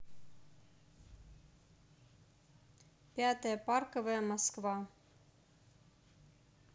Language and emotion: Russian, neutral